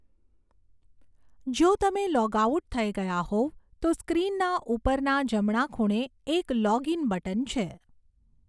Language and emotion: Gujarati, neutral